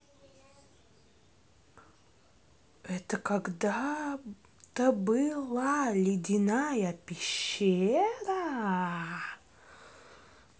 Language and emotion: Russian, neutral